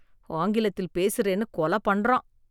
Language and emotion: Tamil, disgusted